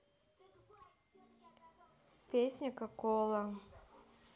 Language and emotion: Russian, neutral